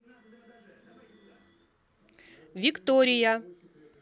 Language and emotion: Russian, neutral